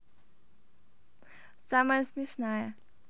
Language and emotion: Russian, positive